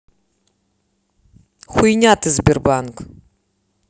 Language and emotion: Russian, angry